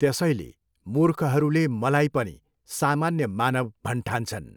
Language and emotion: Nepali, neutral